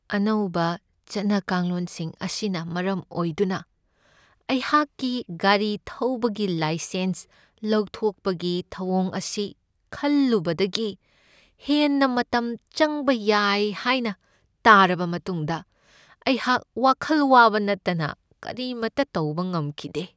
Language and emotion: Manipuri, sad